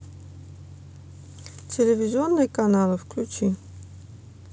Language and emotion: Russian, neutral